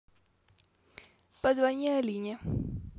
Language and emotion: Russian, neutral